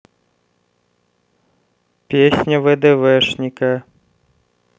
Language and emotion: Russian, neutral